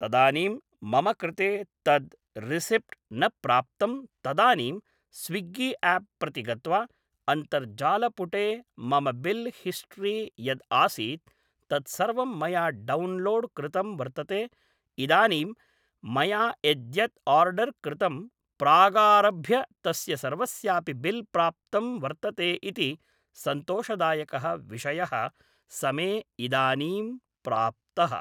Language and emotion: Sanskrit, neutral